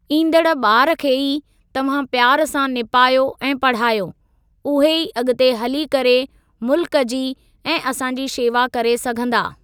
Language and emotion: Sindhi, neutral